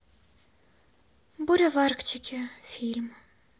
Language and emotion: Russian, sad